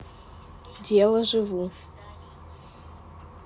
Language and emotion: Russian, neutral